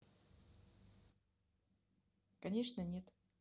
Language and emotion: Russian, neutral